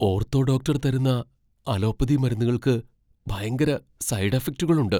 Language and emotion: Malayalam, fearful